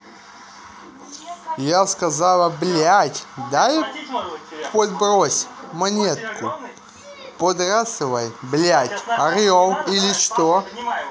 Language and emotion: Russian, angry